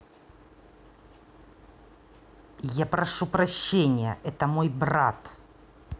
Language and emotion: Russian, angry